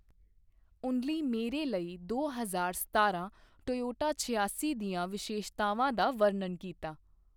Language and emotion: Punjabi, neutral